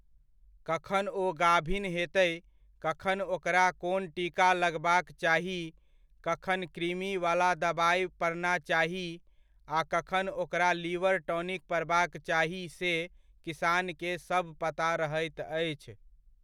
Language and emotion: Maithili, neutral